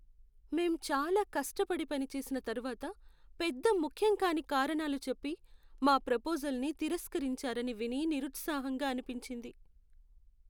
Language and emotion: Telugu, sad